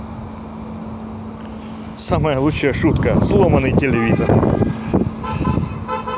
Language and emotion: Russian, positive